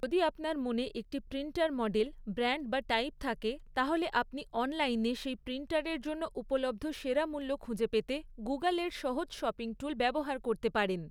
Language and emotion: Bengali, neutral